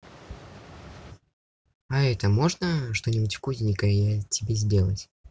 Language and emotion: Russian, neutral